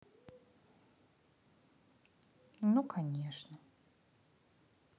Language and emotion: Russian, sad